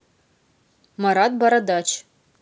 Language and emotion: Russian, neutral